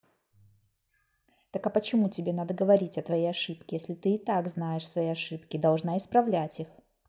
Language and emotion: Russian, angry